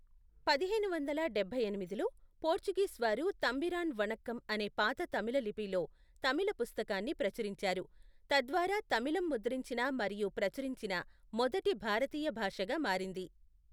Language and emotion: Telugu, neutral